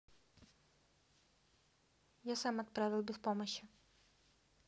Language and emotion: Russian, neutral